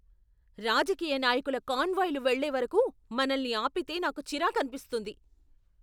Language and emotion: Telugu, angry